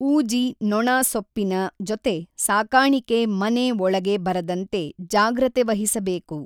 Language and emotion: Kannada, neutral